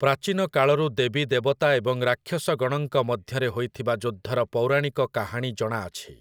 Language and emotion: Odia, neutral